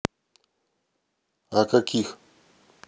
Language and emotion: Russian, neutral